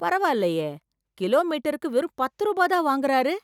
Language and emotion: Tamil, surprised